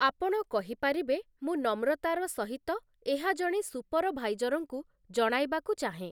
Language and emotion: Odia, neutral